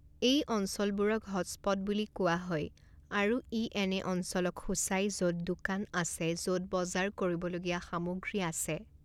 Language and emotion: Assamese, neutral